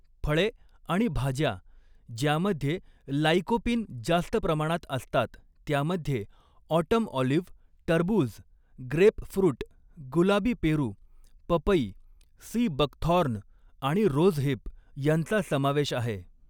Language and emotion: Marathi, neutral